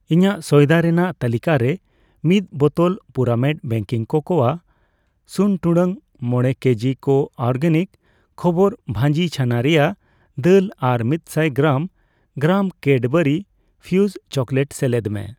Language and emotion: Santali, neutral